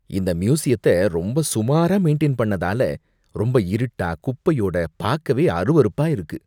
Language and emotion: Tamil, disgusted